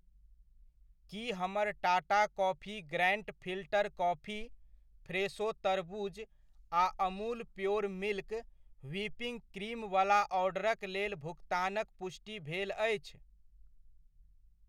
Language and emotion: Maithili, neutral